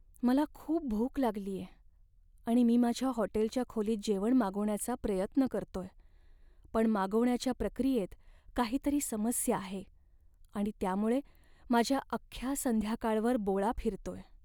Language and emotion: Marathi, sad